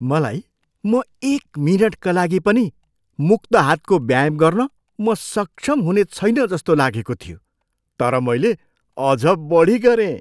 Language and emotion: Nepali, surprised